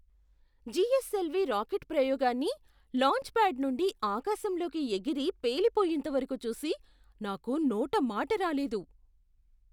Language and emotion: Telugu, surprised